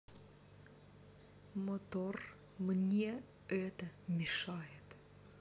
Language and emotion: Russian, neutral